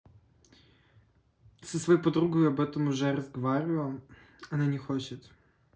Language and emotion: Russian, neutral